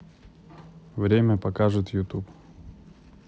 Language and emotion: Russian, neutral